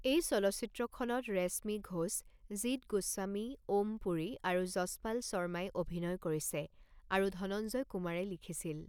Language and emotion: Assamese, neutral